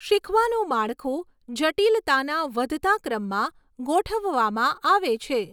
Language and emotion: Gujarati, neutral